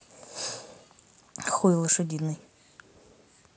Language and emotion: Russian, neutral